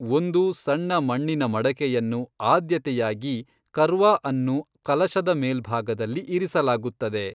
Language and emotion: Kannada, neutral